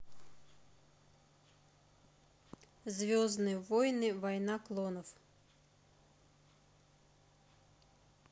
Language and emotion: Russian, neutral